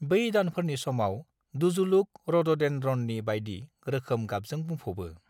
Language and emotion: Bodo, neutral